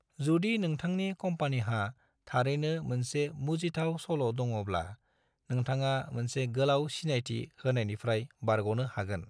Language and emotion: Bodo, neutral